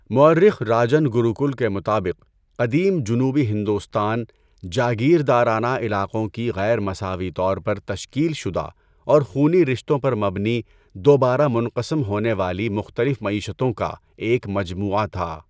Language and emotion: Urdu, neutral